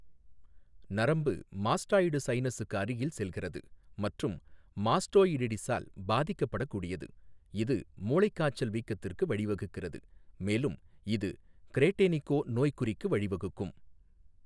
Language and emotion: Tamil, neutral